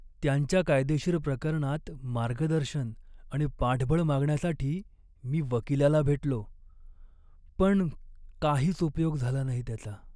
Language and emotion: Marathi, sad